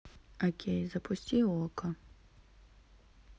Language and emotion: Russian, neutral